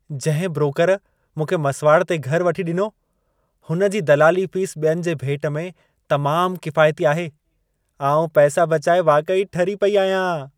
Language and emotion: Sindhi, happy